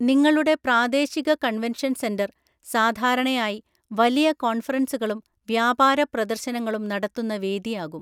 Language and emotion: Malayalam, neutral